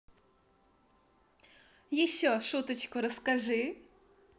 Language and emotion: Russian, positive